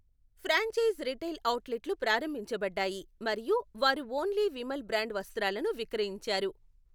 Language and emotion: Telugu, neutral